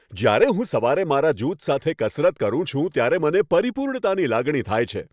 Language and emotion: Gujarati, happy